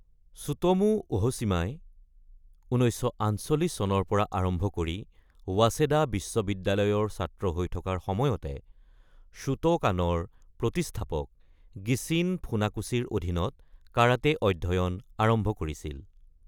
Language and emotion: Assamese, neutral